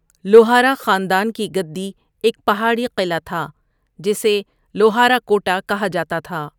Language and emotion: Urdu, neutral